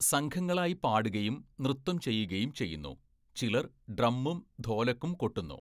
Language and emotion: Malayalam, neutral